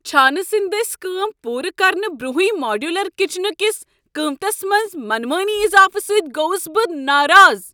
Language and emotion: Kashmiri, angry